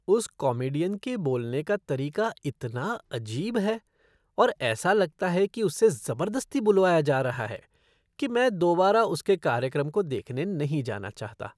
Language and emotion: Hindi, disgusted